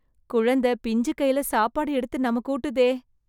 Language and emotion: Tamil, surprised